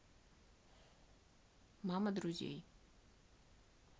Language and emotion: Russian, neutral